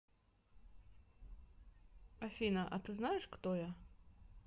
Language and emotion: Russian, neutral